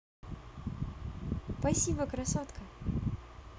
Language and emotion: Russian, positive